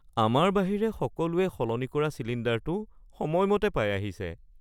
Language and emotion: Assamese, sad